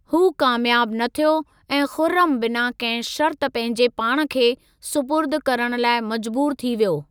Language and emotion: Sindhi, neutral